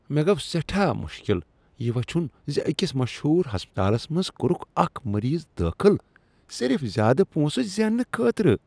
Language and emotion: Kashmiri, disgusted